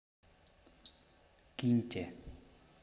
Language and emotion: Russian, neutral